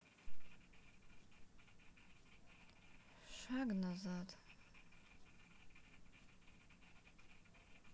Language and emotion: Russian, sad